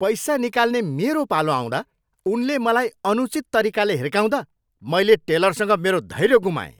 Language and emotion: Nepali, angry